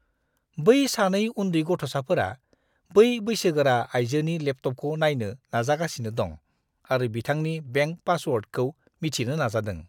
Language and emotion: Bodo, disgusted